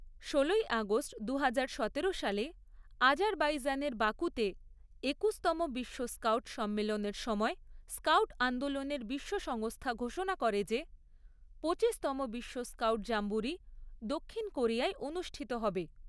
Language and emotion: Bengali, neutral